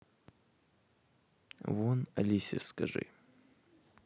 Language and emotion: Russian, neutral